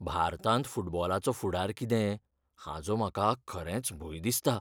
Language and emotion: Goan Konkani, fearful